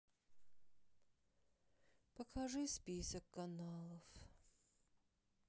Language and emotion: Russian, sad